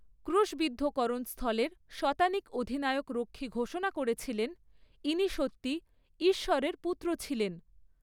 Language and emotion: Bengali, neutral